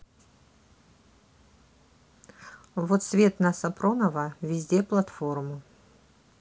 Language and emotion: Russian, neutral